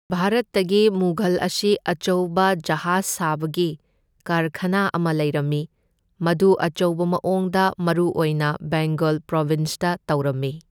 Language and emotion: Manipuri, neutral